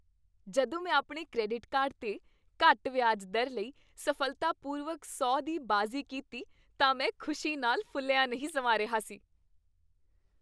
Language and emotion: Punjabi, happy